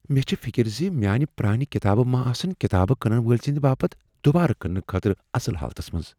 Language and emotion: Kashmiri, fearful